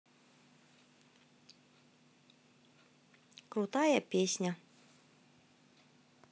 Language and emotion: Russian, positive